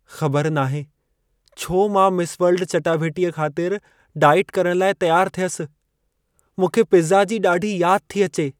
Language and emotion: Sindhi, sad